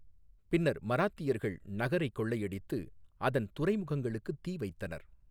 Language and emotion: Tamil, neutral